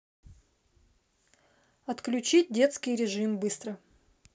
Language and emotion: Russian, neutral